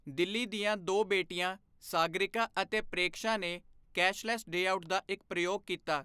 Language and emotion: Punjabi, neutral